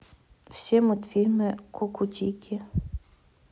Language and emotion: Russian, neutral